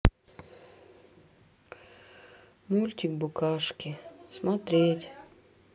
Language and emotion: Russian, sad